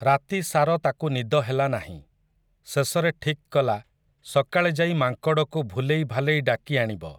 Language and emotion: Odia, neutral